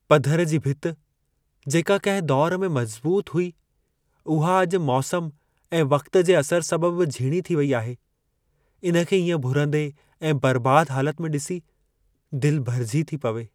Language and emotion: Sindhi, sad